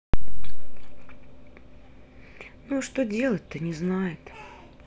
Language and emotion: Russian, sad